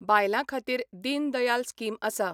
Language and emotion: Goan Konkani, neutral